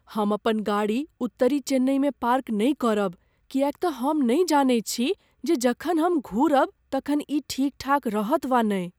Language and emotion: Maithili, fearful